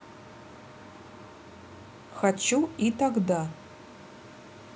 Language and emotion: Russian, neutral